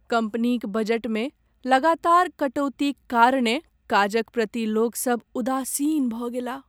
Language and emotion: Maithili, sad